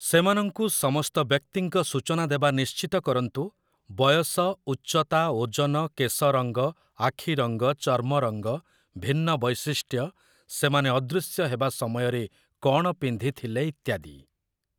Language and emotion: Odia, neutral